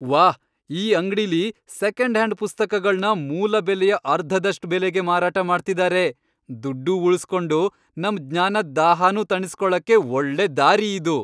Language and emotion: Kannada, happy